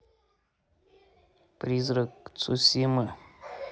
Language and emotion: Russian, neutral